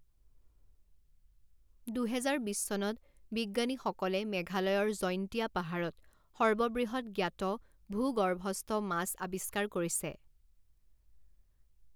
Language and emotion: Assamese, neutral